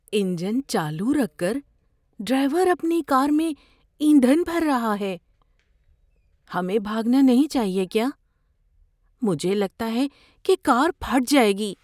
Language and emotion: Urdu, fearful